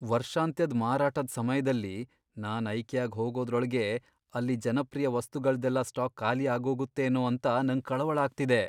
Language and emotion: Kannada, fearful